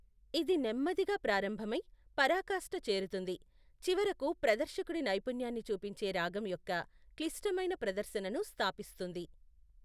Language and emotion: Telugu, neutral